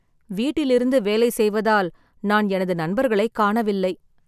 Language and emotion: Tamil, sad